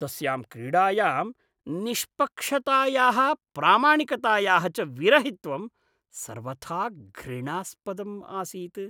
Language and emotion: Sanskrit, disgusted